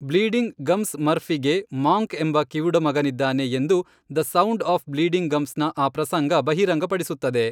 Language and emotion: Kannada, neutral